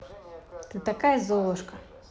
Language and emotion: Russian, positive